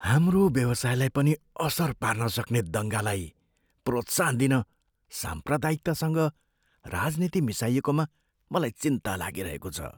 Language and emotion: Nepali, fearful